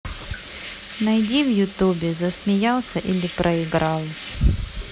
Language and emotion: Russian, neutral